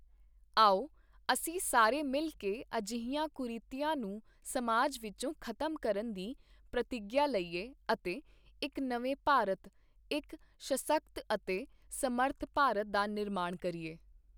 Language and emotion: Punjabi, neutral